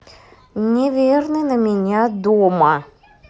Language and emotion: Russian, angry